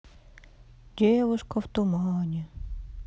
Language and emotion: Russian, sad